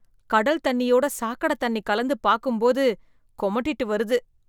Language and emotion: Tamil, disgusted